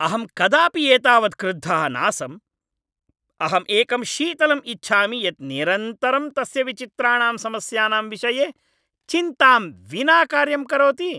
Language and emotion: Sanskrit, angry